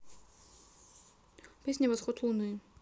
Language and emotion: Russian, neutral